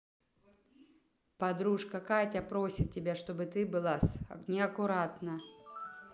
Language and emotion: Russian, neutral